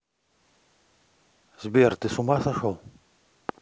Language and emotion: Russian, neutral